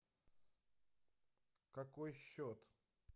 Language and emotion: Russian, neutral